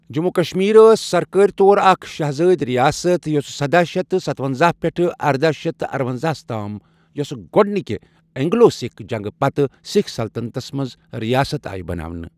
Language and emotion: Kashmiri, neutral